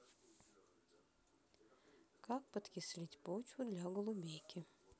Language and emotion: Russian, neutral